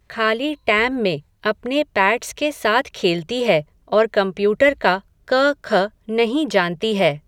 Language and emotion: Hindi, neutral